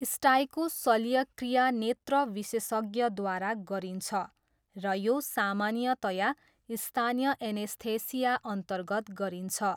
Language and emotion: Nepali, neutral